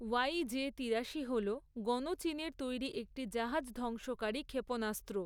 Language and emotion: Bengali, neutral